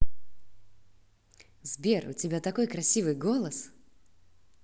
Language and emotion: Russian, positive